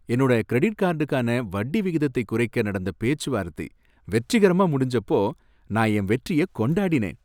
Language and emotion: Tamil, happy